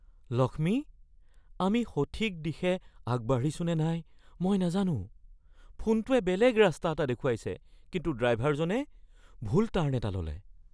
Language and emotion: Assamese, fearful